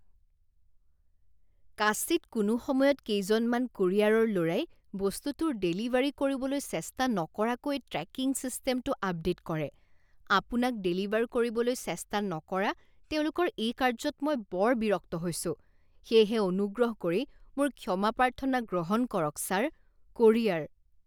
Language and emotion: Assamese, disgusted